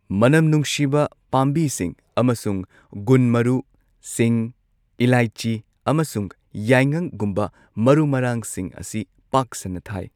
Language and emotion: Manipuri, neutral